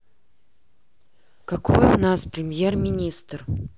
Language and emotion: Russian, neutral